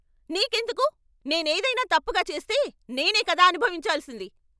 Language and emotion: Telugu, angry